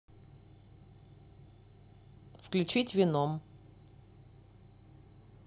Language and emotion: Russian, neutral